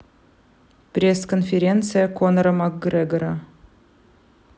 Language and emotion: Russian, neutral